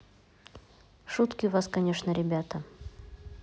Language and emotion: Russian, neutral